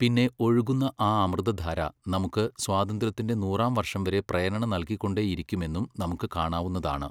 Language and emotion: Malayalam, neutral